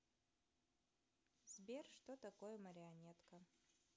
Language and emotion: Russian, neutral